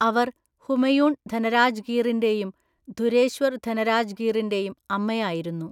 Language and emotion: Malayalam, neutral